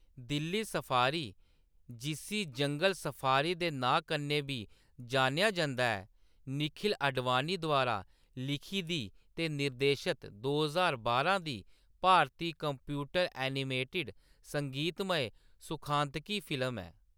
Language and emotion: Dogri, neutral